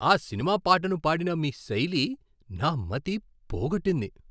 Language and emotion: Telugu, surprised